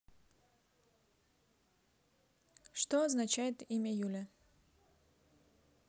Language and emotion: Russian, neutral